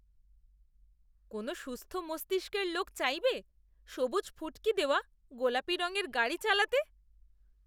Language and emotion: Bengali, disgusted